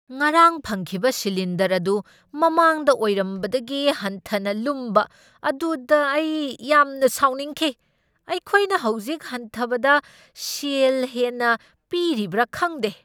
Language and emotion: Manipuri, angry